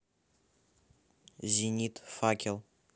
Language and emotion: Russian, neutral